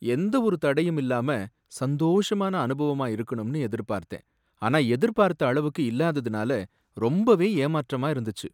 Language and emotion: Tamil, sad